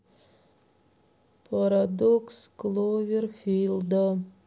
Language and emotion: Russian, sad